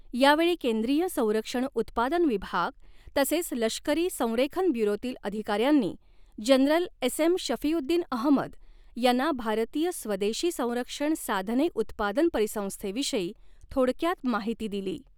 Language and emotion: Marathi, neutral